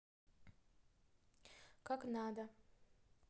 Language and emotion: Russian, neutral